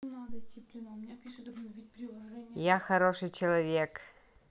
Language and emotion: Russian, positive